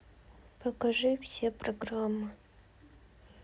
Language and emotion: Russian, sad